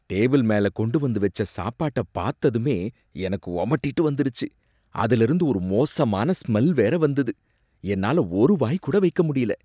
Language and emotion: Tamil, disgusted